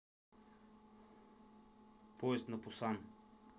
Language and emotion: Russian, neutral